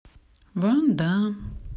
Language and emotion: Russian, sad